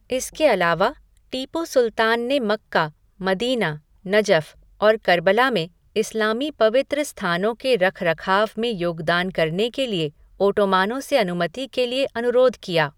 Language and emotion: Hindi, neutral